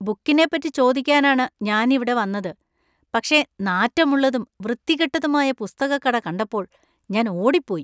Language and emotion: Malayalam, disgusted